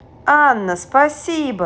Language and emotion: Russian, positive